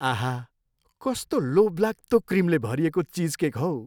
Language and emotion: Nepali, happy